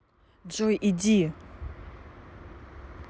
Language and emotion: Russian, angry